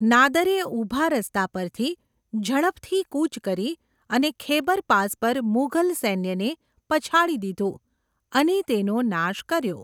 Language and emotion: Gujarati, neutral